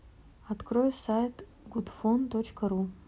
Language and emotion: Russian, neutral